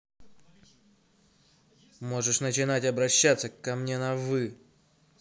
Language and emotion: Russian, angry